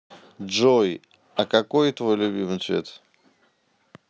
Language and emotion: Russian, neutral